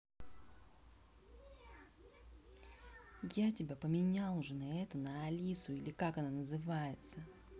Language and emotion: Russian, angry